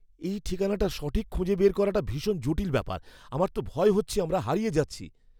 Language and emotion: Bengali, fearful